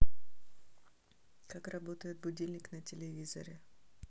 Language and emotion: Russian, neutral